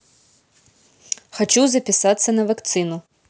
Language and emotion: Russian, neutral